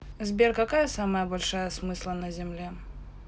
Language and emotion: Russian, neutral